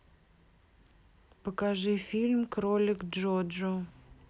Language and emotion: Russian, neutral